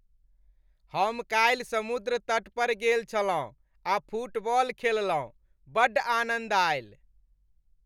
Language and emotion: Maithili, happy